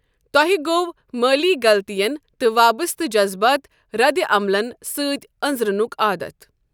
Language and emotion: Kashmiri, neutral